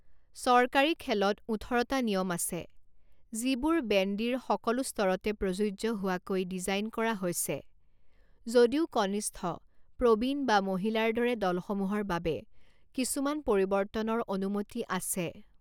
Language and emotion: Assamese, neutral